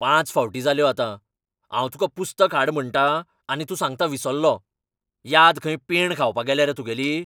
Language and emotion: Goan Konkani, angry